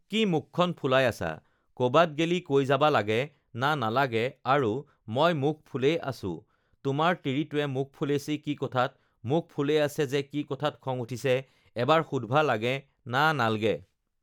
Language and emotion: Assamese, neutral